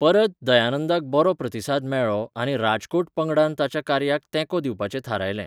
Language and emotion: Goan Konkani, neutral